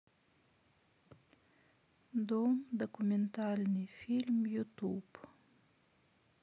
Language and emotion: Russian, sad